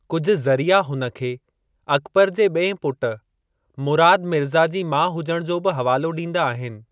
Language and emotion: Sindhi, neutral